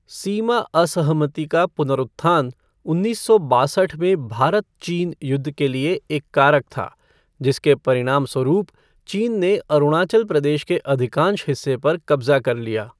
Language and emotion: Hindi, neutral